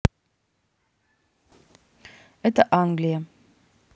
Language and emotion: Russian, neutral